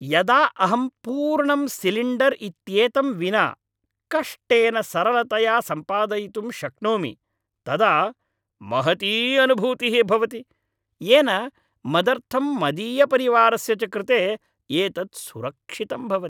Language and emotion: Sanskrit, happy